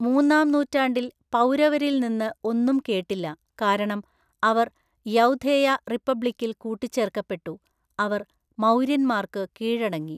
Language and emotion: Malayalam, neutral